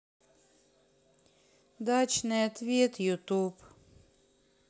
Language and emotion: Russian, sad